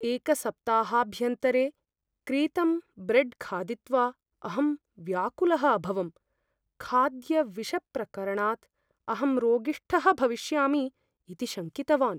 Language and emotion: Sanskrit, fearful